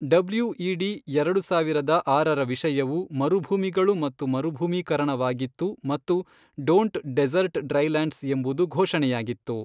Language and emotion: Kannada, neutral